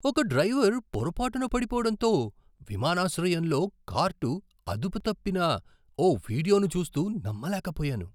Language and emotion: Telugu, surprised